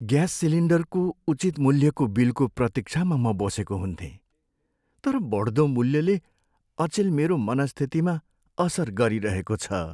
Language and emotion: Nepali, sad